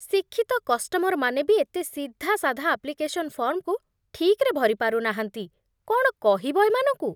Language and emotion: Odia, disgusted